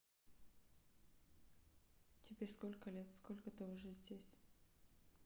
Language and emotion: Russian, neutral